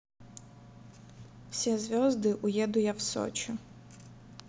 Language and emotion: Russian, neutral